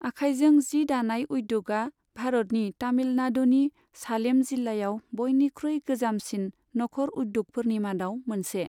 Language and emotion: Bodo, neutral